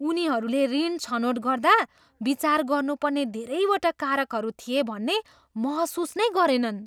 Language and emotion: Nepali, surprised